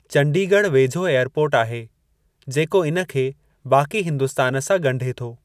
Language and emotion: Sindhi, neutral